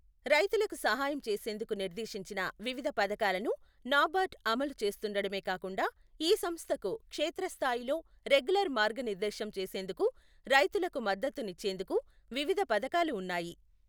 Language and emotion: Telugu, neutral